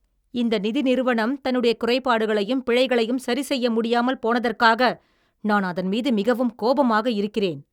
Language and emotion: Tamil, angry